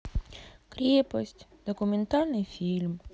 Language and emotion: Russian, sad